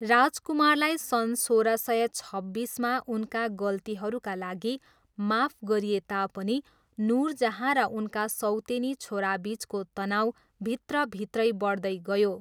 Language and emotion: Nepali, neutral